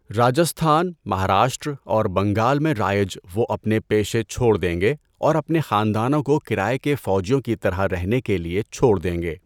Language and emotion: Urdu, neutral